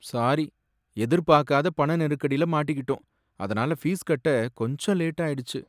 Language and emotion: Tamil, sad